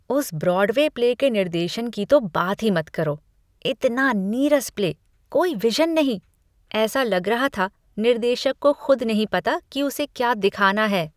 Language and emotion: Hindi, disgusted